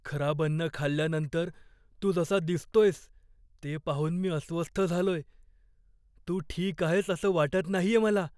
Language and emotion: Marathi, fearful